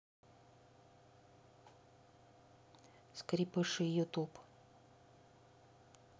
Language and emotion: Russian, neutral